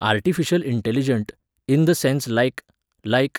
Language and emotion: Goan Konkani, neutral